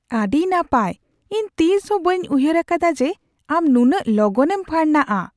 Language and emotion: Santali, surprised